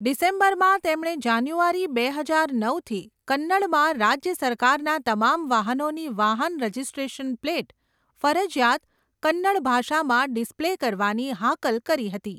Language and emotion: Gujarati, neutral